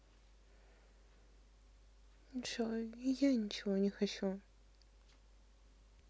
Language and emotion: Russian, sad